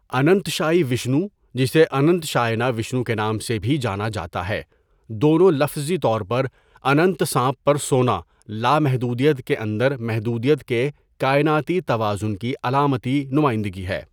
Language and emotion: Urdu, neutral